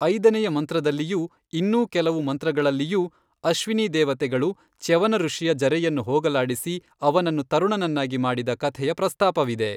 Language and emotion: Kannada, neutral